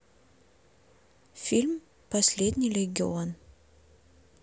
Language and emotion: Russian, neutral